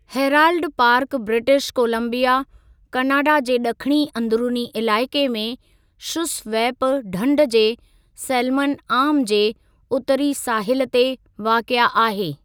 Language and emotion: Sindhi, neutral